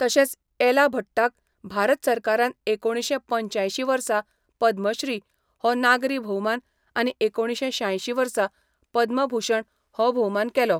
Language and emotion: Goan Konkani, neutral